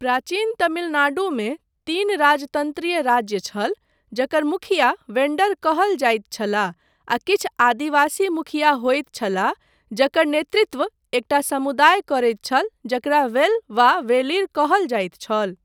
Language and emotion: Maithili, neutral